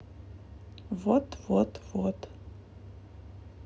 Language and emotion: Russian, neutral